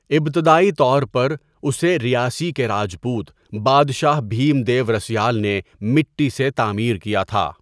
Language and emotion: Urdu, neutral